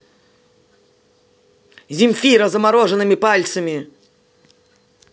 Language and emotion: Russian, angry